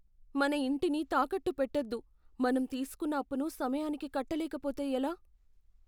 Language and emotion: Telugu, fearful